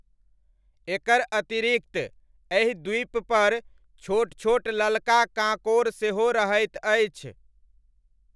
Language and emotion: Maithili, neutral